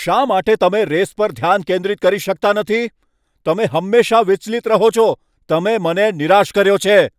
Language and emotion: Gujarati, angry